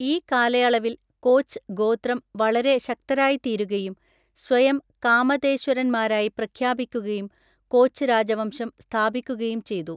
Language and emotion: Malayalam, neutral